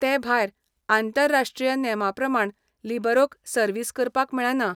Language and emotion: Goan Konkani, neutral